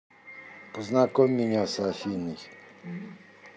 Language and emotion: Russian, neutral